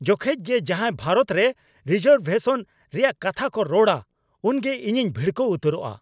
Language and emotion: Santali, angry